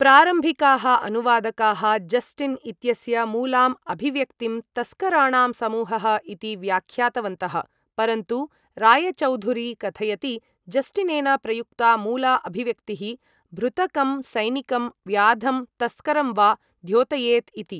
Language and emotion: Sanskrit, neutral